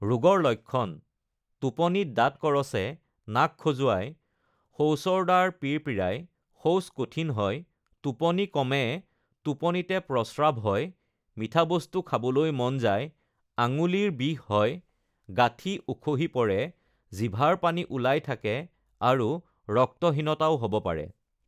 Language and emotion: Assamese, neutral